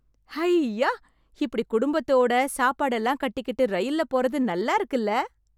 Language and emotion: Tamil, happy